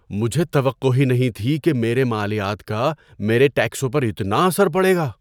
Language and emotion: Urdu, surprised